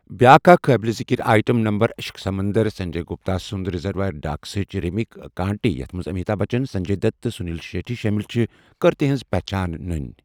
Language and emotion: Kashmiri, neutral